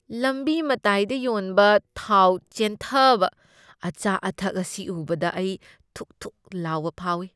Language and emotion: Manipuri, disgusted